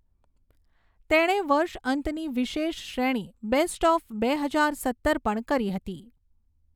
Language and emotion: Gujarati, neutral